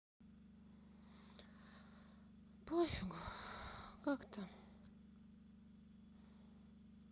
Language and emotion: Russian, sad